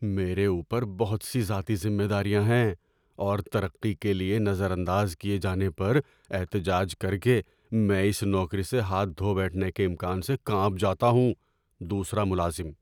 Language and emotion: Urdu, fearful